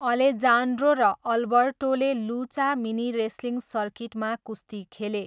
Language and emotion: Nepali, neutral